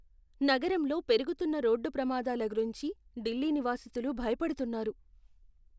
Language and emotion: Telugu, fearful